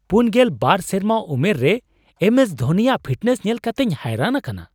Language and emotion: Santali, surprised